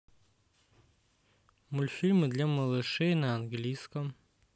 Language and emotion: Russian, neutral